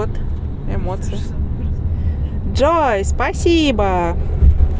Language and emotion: Russian, positive